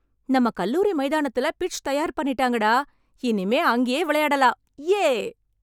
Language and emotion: Tamil, happy